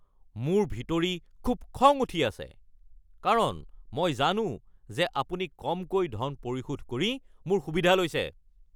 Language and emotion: Assamese, angry